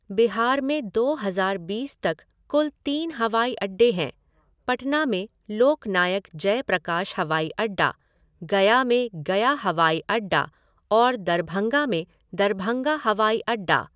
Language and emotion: Hindi, neutral